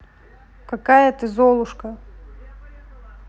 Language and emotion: Russian, neutral